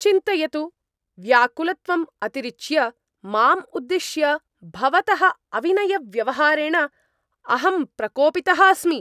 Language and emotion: Sanskrit, angry